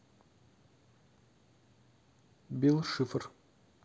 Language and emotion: Russian, neutral